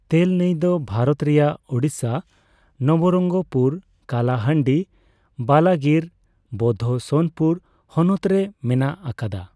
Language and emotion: Santali, neutral